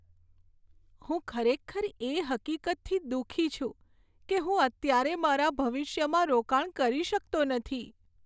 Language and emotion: Gujarati, sad